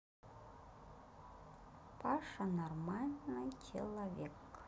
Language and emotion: Russian, neutral